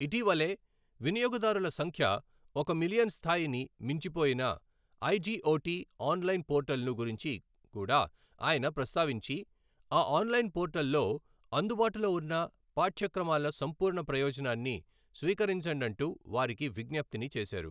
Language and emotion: Telugu, neutral